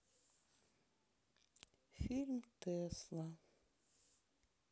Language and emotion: Russian, sad